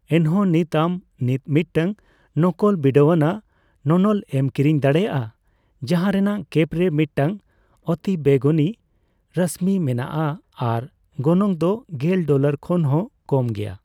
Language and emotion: Santali, neutral